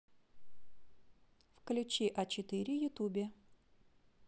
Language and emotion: Russian, neutral